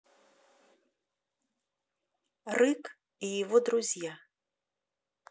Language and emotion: Russian, neutral